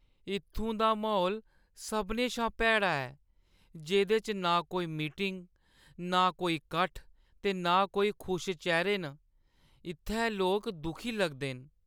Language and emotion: Dogri, sad